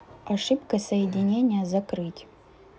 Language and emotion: Russian, neutral